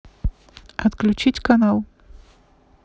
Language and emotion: Russian, neutral